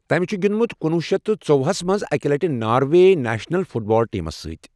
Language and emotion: Kashmiri, neutral